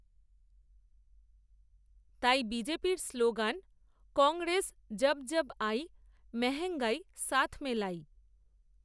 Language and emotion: Bengali, neutral